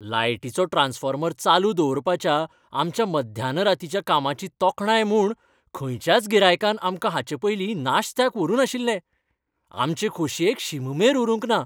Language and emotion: Goan Konkani, happy